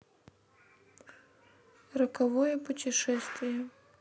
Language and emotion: Russian, sad